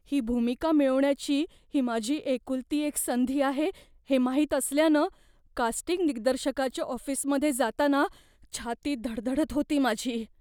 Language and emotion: Marathi, fearful